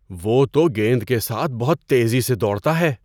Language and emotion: Urdu, surprised